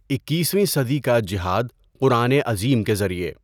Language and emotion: Urdu, neutral